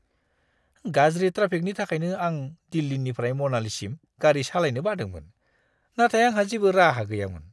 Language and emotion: Bodo, disgusted